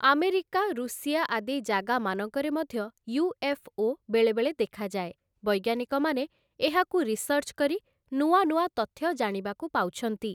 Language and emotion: Odia, neutral